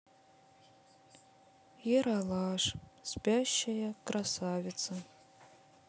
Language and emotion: Russian, sad